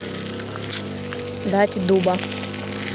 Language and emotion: Russian, neutral